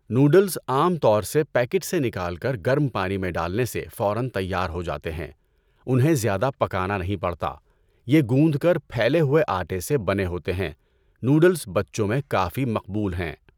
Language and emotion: Urdu, neutral